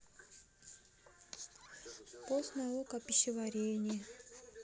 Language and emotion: Russian, sad